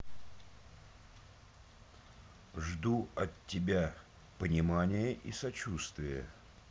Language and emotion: Russian, neutral